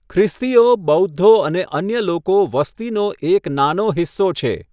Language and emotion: Gujarati, neutral